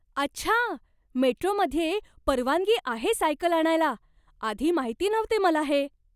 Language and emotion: Marathi, surprised